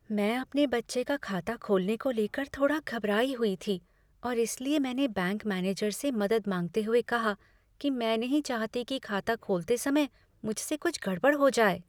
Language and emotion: Hindi, fearful